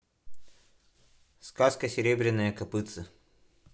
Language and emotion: Russian, neutral